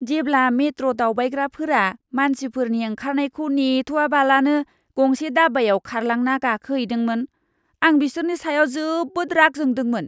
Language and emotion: Bodo, disgusted